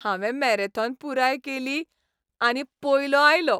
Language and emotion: Goan Konkani, happy